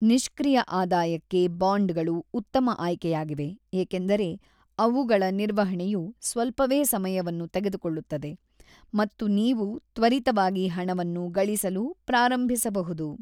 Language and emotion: Kannada, neutral